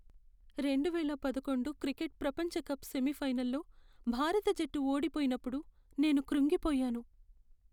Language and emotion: Telugu, sad